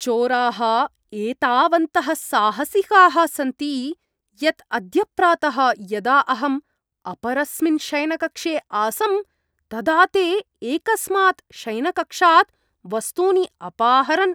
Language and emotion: Sanskrit, disgusted